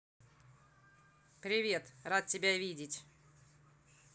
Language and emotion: Russian, neutral